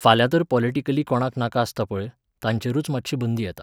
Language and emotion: Goan Konkani, neutral